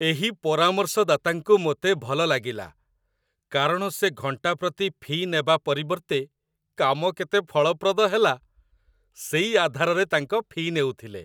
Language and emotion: Odia, happy